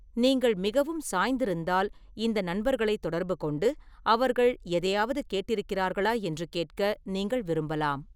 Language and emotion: Tamil, neutral